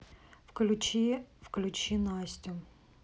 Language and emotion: Russian, neutral